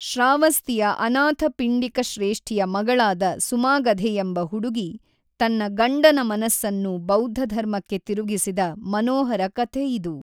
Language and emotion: Kannada, neutral